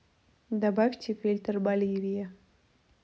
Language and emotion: Russian, neutral